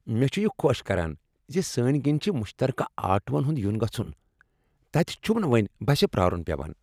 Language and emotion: Kashmiri, happy